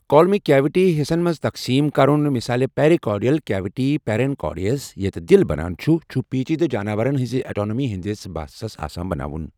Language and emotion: Kashmiri, neutral